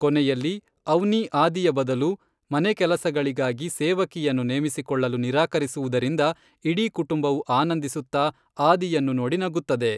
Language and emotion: Kannada, neutral